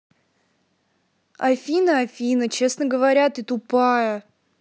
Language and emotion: Russian, angry